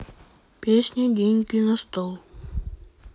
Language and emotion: Russian, neutral